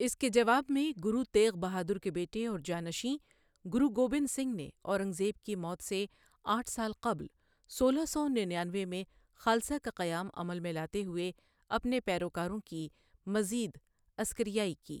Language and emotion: Urdu, neutral